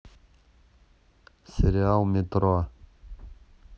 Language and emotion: Russian, neutral